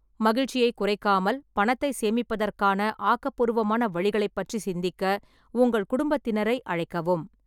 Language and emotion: Tamil, neutral